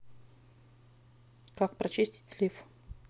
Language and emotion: Russian, neutral